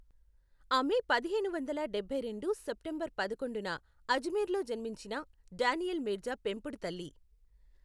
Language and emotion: Telugu, neutral